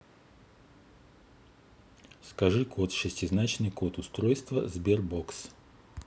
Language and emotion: Russian, neutral